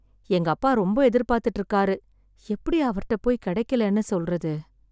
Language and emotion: Tamil, sad